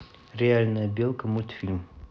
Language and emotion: Russian, neutral